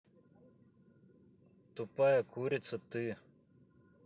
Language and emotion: Russian, neutral